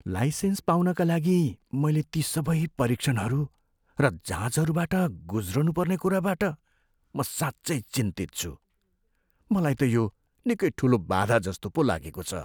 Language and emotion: Nepali, fearful